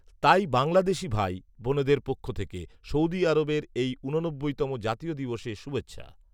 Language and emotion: Bengali, neutral